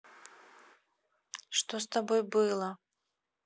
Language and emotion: Russian, neutral